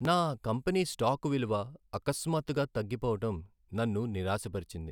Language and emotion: Telugu, sad